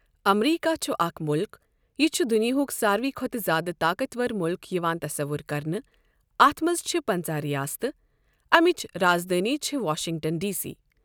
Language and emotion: Kashmiri, neutral